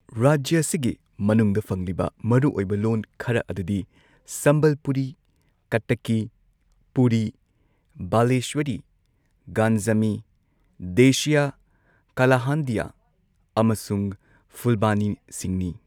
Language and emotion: Manipuri, neutral